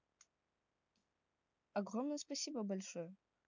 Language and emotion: Russian, neutral